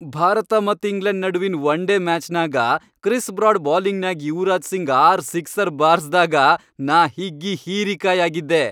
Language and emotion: Kannada, happy